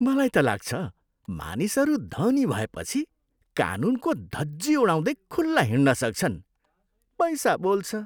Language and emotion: Nepali, disgusted